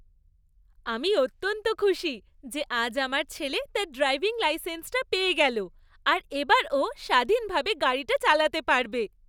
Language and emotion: Bengali, happy